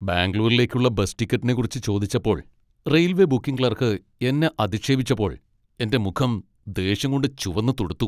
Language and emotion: Malayalam, angry